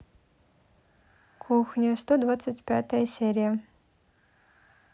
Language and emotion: Russian, neutral